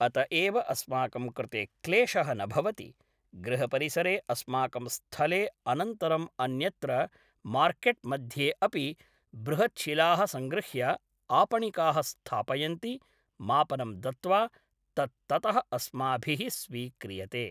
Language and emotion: Sanskrit, neutral